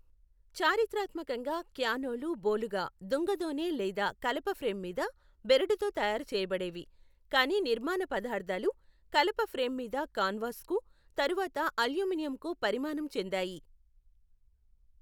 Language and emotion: Telugu, neutral